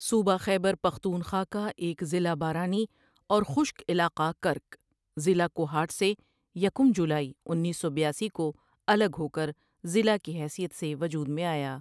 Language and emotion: Urdu, neutral